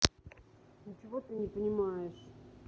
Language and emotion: Russian, neutral